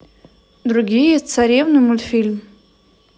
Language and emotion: Russian, neutral